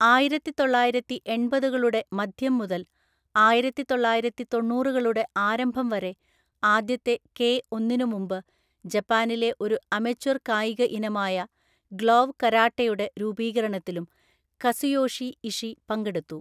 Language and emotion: Malayalam, neutral